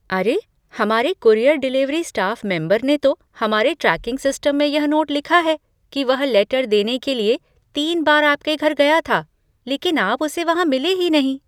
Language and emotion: Hindi, surprised